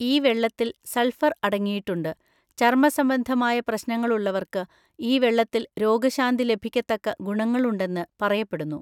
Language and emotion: Malayalam, neutral